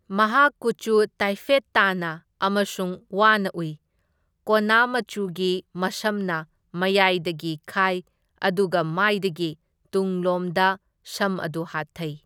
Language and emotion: Manipuri, neutral